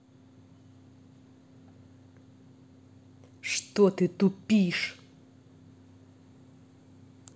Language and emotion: Russian, angry